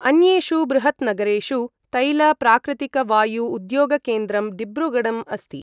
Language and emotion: Sanskrit, neutral